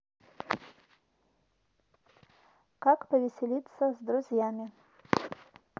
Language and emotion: Russian, neutral